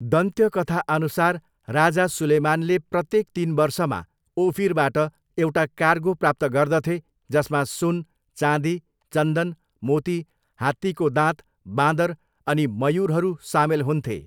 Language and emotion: Nepali, neutral